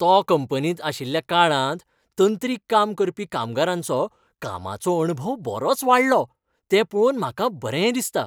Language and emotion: Goan Konkani, happy